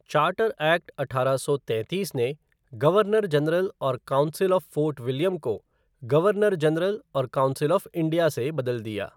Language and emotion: Hindi, neutral